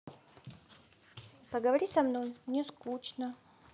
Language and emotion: Russian, sad